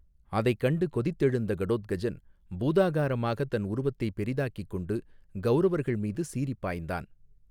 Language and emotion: Tamil, neutral